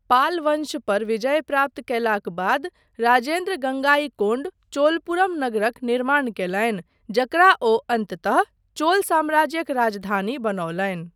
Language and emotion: Maithili, neutral